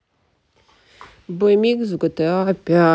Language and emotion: Russian, sad